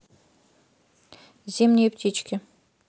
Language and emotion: Russian, neutral